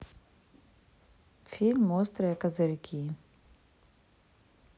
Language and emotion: Russian, neutral